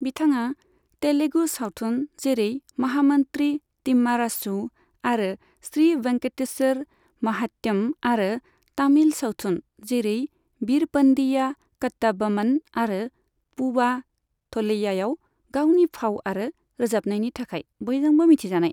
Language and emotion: Bodo, neutral